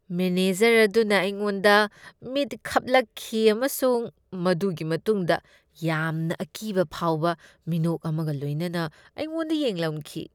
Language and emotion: Manipuri, disgusted